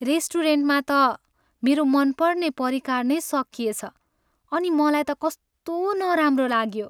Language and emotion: Nepali, sad